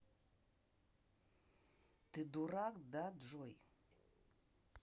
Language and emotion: Russian, angry